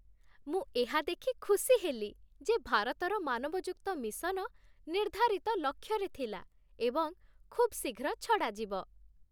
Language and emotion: Odia, happy